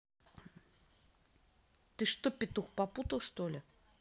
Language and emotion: Russian, angry